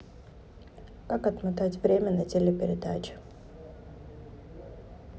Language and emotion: Russian, neutral